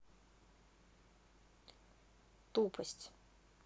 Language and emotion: Russian, neutral